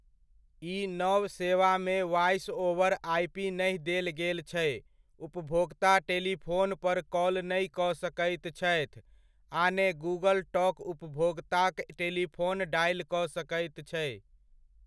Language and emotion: Maithili, neutral